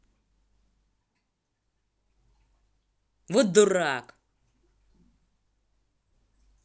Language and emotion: Russian, angry